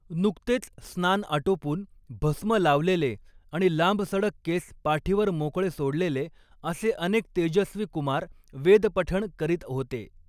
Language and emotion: Marathi, neutral